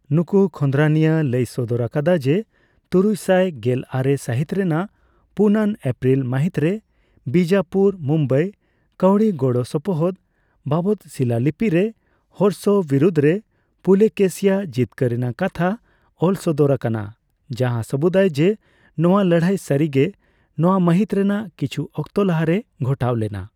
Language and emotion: Santali, neutral